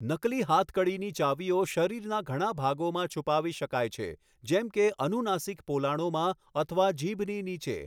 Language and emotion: Gujarati, neutral